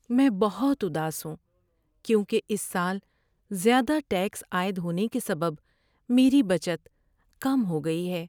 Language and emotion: Urdu, sad